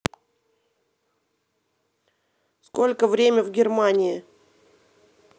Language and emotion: Russian, neutral